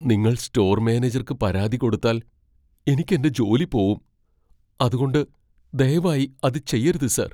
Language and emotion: Malayalam, fearful